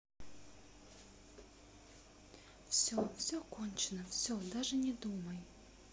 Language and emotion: Russian, sad